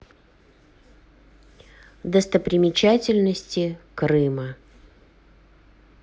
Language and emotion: Russian, neutral